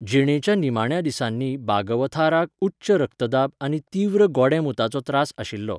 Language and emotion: Goan Konkani, neutral